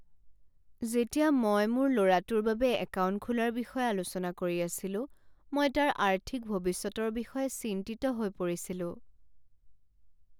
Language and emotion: Assamese, sad